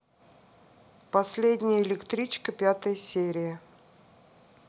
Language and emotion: Russian, neutral